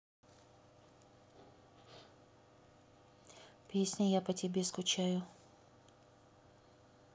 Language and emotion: Russian, neutral